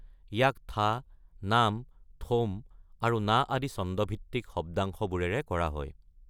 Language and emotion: Assamese, neutral